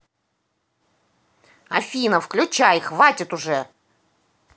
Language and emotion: Russian, angry